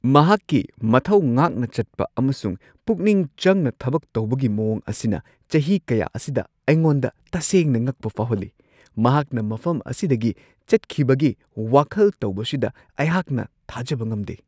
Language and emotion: Manipuri, surprised